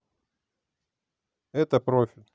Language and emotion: Russian, neutral